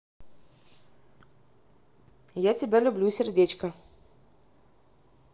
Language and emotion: Russian, positive